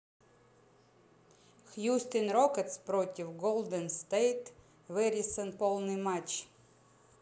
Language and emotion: Russian, neutral